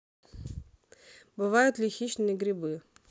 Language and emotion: Russian, neutral